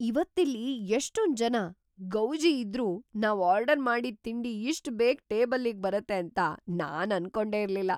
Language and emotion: Kannada, surprised